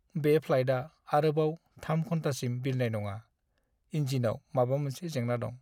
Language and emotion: Bodo, sad